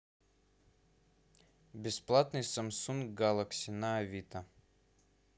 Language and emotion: Russian, neutral